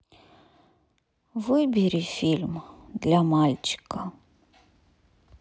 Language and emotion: Russian, sad